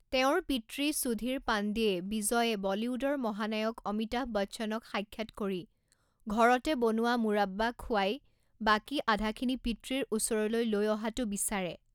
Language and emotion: Assamese, neutral